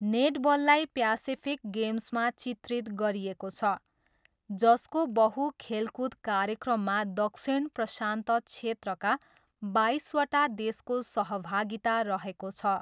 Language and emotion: Nepali, neutral